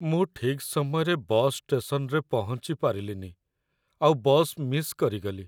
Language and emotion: Odia, sad